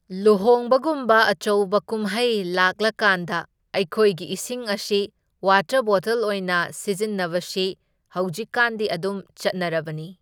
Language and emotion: Manipuri, neutral